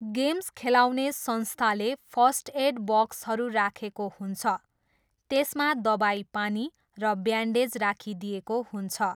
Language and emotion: Nepali, neutral